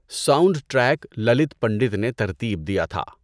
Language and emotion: Urdu, neutral